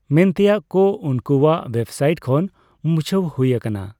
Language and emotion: Santali, neutral